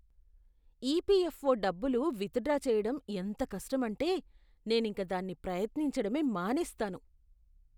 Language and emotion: Telugu, disgusted